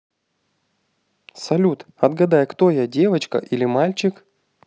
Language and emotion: Russian, positive